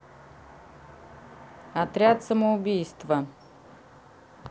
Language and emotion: Russian, neutral